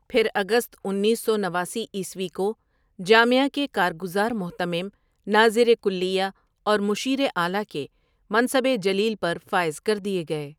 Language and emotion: Urdu, neutral